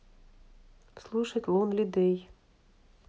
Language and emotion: Russian, neutral